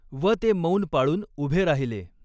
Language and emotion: Marathi, neutral